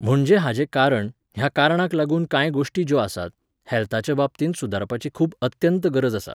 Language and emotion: Goan Konkani, neutral